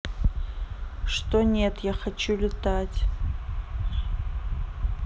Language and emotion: Russian, neutral